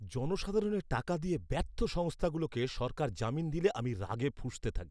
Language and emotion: Bengali, angry